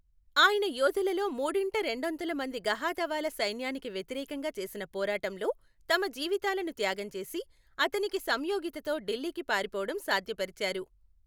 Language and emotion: Telugu, neutral